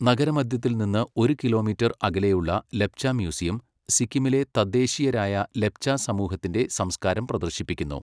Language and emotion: Malayalam, neutral